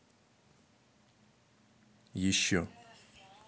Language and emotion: Russian, neutral